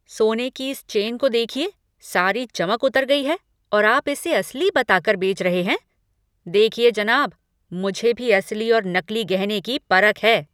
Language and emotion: Hindi, angry